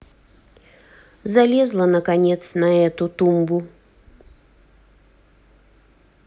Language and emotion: Russian, neutral